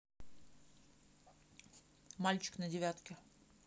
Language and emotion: Russian, neutral